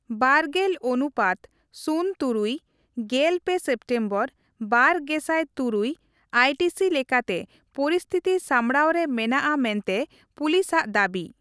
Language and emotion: Santali, neutral